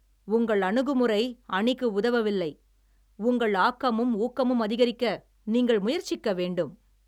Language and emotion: Tamil, angry